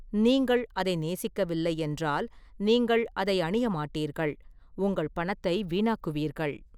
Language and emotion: Tamil, neutral